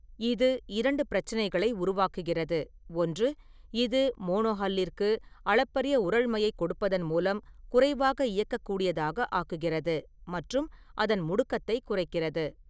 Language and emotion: Tamil, neutral